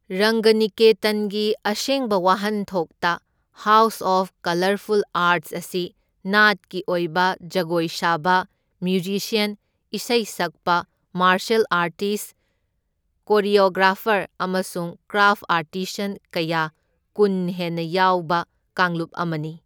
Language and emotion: Manipuri, neutral